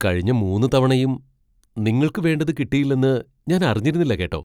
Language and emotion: Malayalam, surprised